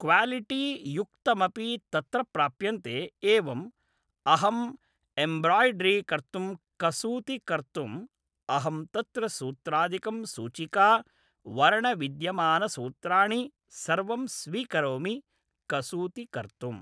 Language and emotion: Sanskrit, neutral